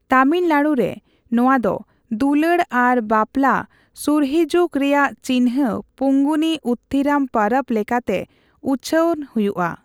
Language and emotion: Santali, neutral